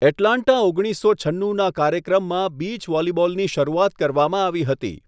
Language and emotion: Gujarati, neutral